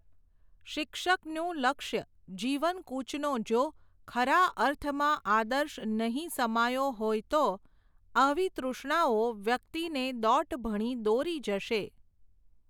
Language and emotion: Gujarati, neutral